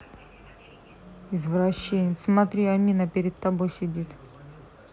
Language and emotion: Russian, neutral